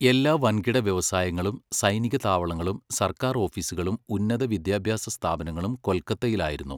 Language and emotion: Malayalam, neutral